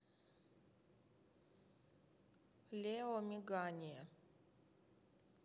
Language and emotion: Russian, neutral